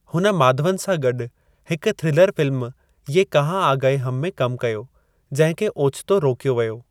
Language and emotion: Sindhi, neutral